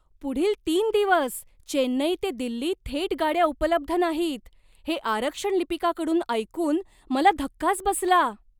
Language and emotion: Marathi, surprised